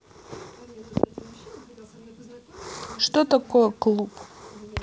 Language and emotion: Russian, neutral